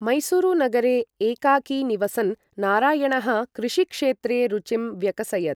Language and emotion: Sanskrit, neutral